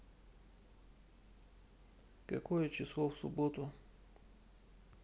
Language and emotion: Russian, neutral